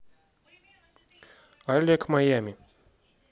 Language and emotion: Russian, neutral